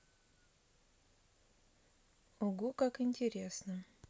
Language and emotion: Russian, neutral